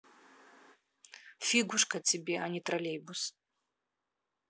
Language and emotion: Russian, neutral